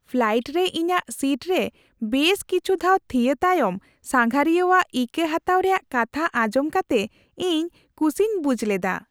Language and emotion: Santali, happy